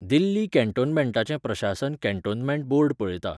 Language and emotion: Goan Konkani, neutral